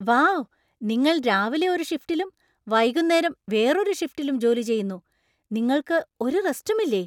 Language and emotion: Malayalam, surprised